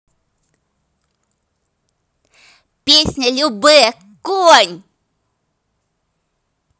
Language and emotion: Russian, positive